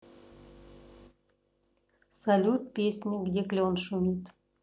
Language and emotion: Russian, neutral